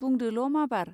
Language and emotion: Bodo, neutral